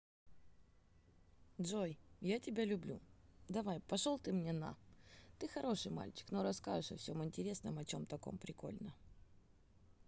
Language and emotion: Russian, neutral